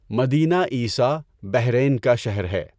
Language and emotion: Urdu, neutral